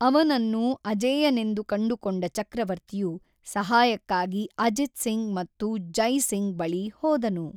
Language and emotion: Kannada, neutral